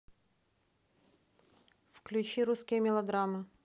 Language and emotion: Russian, neutral